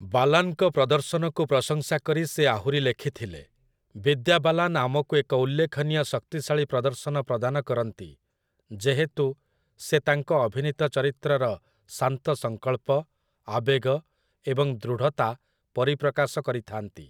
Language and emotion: Odia, neutral